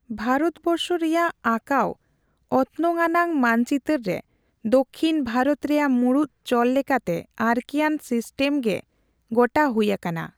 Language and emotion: Santali, neutral